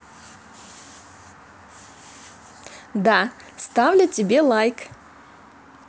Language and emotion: Russian, positive